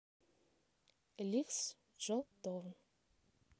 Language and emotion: Russian, neutral